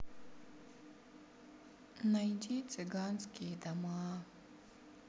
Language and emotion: Russian, sad